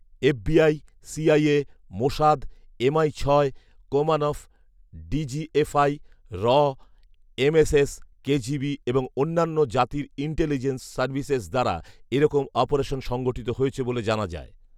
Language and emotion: Bengali, neutral